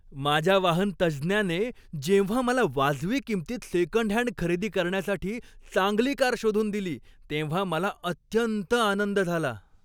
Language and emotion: Marathi, happy